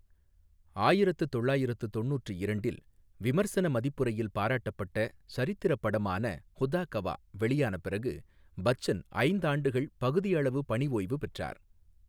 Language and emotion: Tamil, neutral